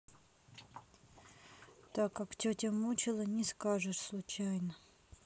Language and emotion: Russian, sad